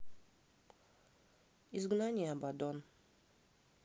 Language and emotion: Russian, neutral